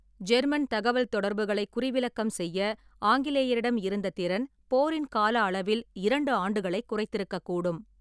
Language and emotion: Tamil, neutral